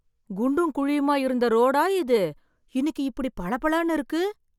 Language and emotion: Tamil, surprised